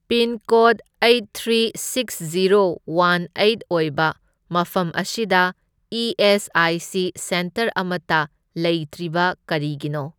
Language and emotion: Manipuri, neutral